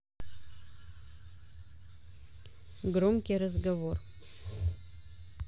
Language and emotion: Russian, neutral